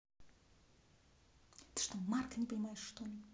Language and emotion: Russian, neutral